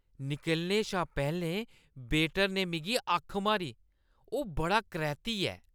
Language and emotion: Dogri, disgusted